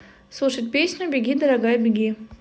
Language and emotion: Russian, neutral